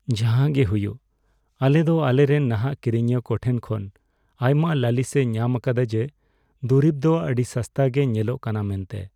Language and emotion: Santali, sad